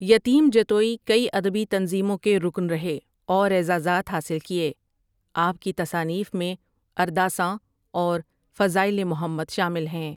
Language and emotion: Urdu, neutral